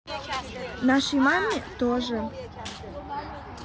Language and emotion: Russian, neutral